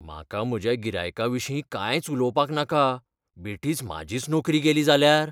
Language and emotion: Goan Konkani, fearful